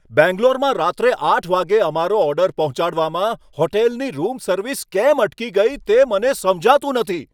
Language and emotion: Gujarati, angry